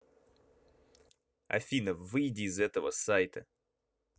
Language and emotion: Russian, angry